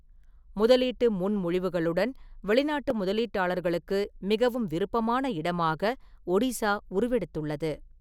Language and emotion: Tamil, neutral